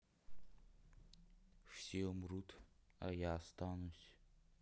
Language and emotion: Russian, sad